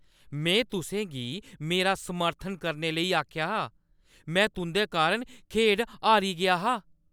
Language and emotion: Dogri, angry